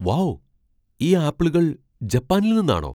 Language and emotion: Malayalam, surprised